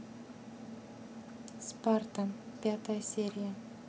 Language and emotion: Russian, neutral